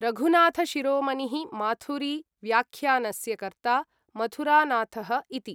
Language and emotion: Sanskrit, neutral